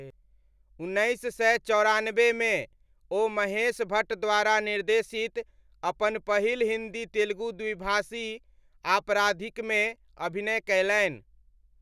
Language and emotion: Maithili, neutral